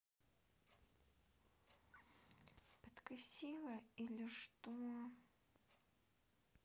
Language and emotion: Russian, neutral